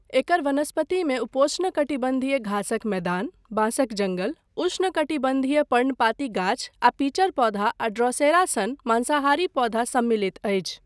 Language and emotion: Maithili, neutral